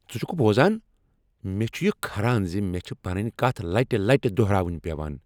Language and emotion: Kashmiri, angry